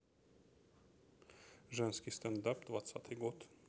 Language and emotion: Russian, neutral